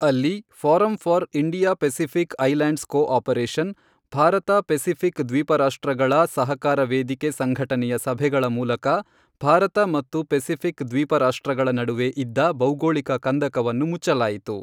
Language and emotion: Kannada, neutral